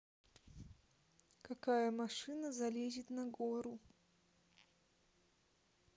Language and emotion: Russian, neutral